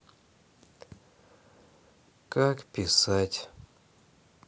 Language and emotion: Russian, sad